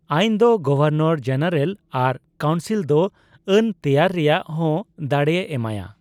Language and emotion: Santali, neutral